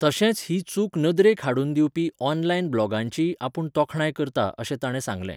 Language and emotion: Goan Konkani, neutral